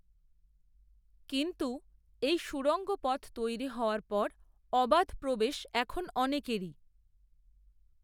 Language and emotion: Bengali, neutral